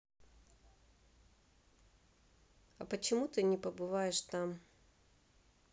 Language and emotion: Russian, neutral